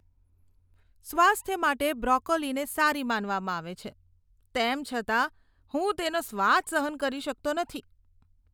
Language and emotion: Gujarati, disgusted